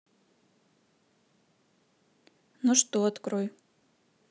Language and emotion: Russian, neutral